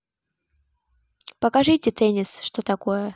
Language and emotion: Russian, neutral